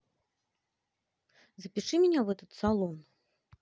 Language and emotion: Russian, positive